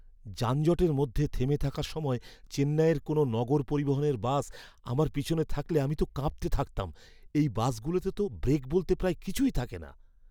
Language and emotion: Bengali, fearful